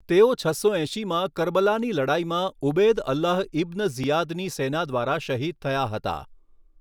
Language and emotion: Gujarati, neutral